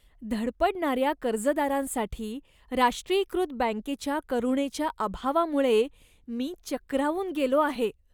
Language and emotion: Marathi, disgusted